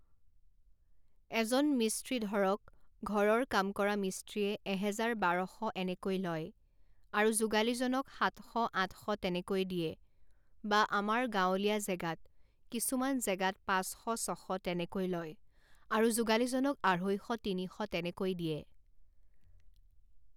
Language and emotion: Assamese, neutral